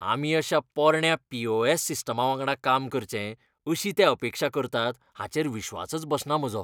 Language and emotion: Goan Konkani, disgusted